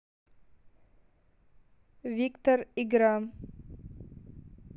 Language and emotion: Russian, neutral